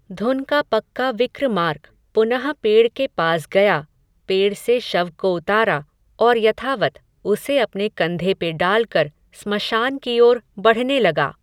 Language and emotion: Hindi, neutral